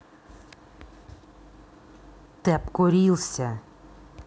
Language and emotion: Russian, angry